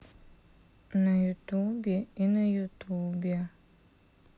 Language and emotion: Russian, sad